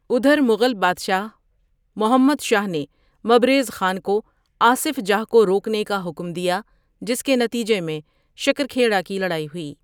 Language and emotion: Urdu, neutral